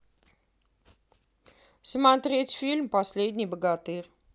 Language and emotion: Russian, neutral